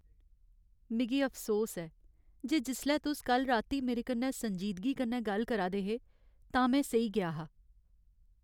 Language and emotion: Dogri, sad